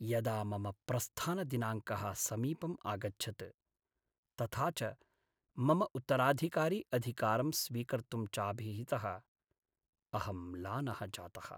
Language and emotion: Sanskrit, sad